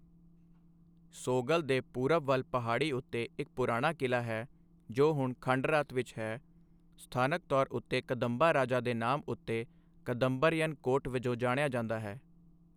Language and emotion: Punjabi, neutral